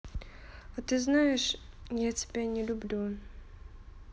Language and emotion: Russian, neutral